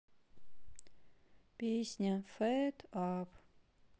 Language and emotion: Russian, sad